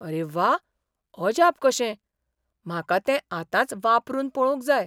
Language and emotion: Goan Konkani, surprised